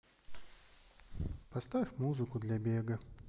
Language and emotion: Russian, sad